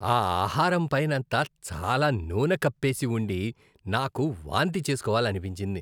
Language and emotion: Telugu, disgusted